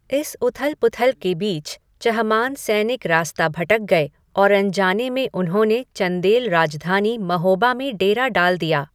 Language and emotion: Hindi, neutral